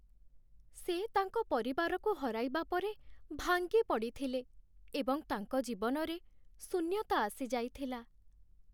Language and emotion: Odia, sad